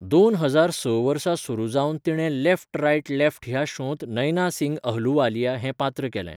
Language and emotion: Goan Konkani, neutral